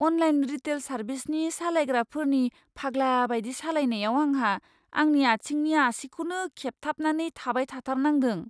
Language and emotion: Bodo, fearful